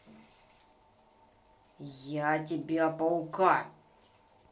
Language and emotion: Russian, angry